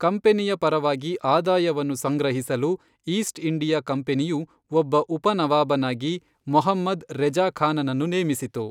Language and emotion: Kannada, neutral